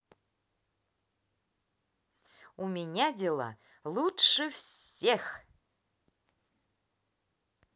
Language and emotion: Russian, positive